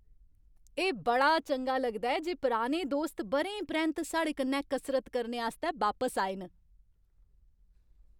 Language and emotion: Dogri, happy